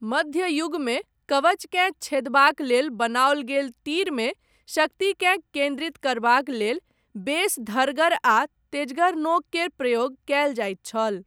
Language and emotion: Maithili, neutral